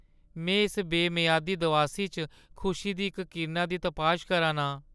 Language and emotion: Dogri, sad